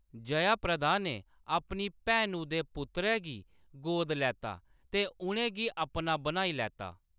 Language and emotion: Dogri, neutral